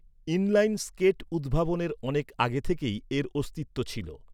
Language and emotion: Bengali, neutral